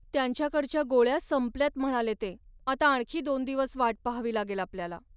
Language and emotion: Marathi, sad